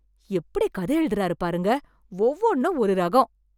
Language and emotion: Tamil, surprised